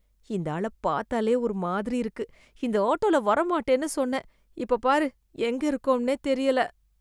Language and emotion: Tamil, disgusted